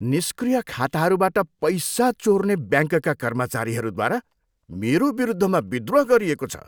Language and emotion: Nepali, disgusted